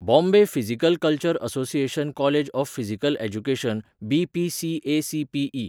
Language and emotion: Goan Konkani, neutral